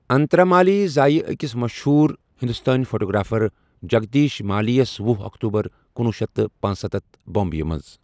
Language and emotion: Kashmiri, neutral